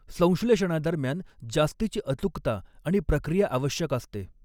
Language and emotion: Marathi, neutral